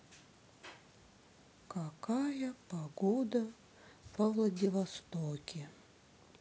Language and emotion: Russian, sad